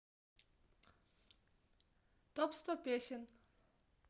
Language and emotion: Russian, neutral